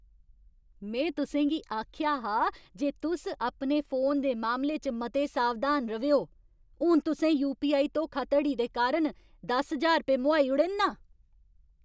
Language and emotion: Dogri, angry